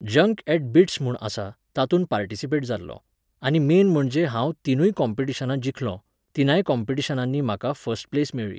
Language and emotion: Goan Konkani, neutral